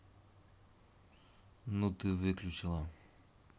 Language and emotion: Russian, neutral